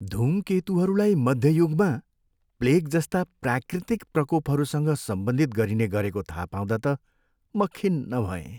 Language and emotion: Nepali, sad